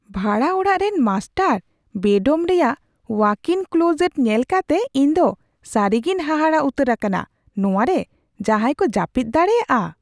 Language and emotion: Santali, surprised